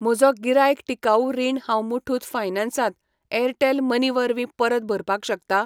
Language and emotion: Goan Konkani, neutral